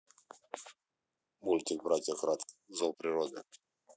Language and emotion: Russian, neutral